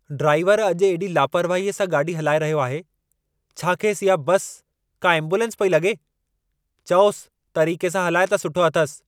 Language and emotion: Sindhi, angry